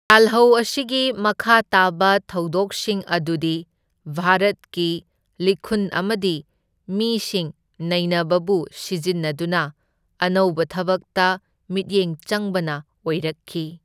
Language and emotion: Manipuri, neutral